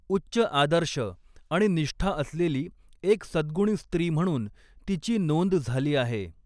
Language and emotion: Marathi, neutral